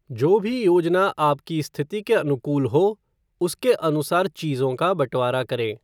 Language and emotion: Hindi, neutral